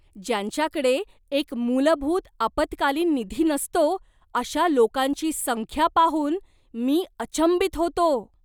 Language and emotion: Marathi, surprised